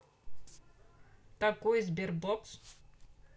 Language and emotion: Russian, neutral